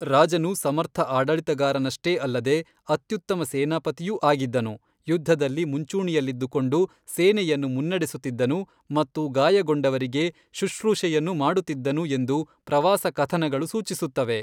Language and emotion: Kannada, neutral